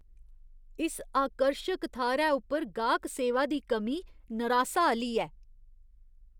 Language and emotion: Dogri, disgusted